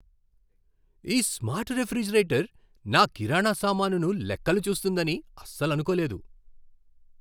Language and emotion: Telugu, surprised